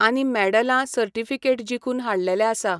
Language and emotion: Goan Konkani, neutral